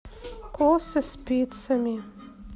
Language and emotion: Russian, neutral